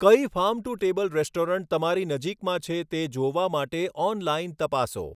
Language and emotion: Gujarati, neutral